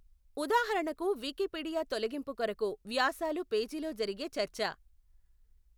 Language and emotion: Telugu, neutral